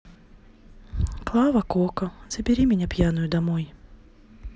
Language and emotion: Russian, sad